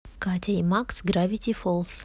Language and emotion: Russian, neutral